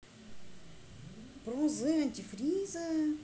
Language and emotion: Russian, neutral